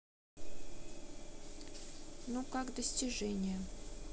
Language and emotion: Russian, neutral